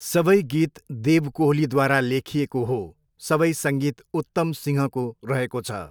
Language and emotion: Nepali, neutral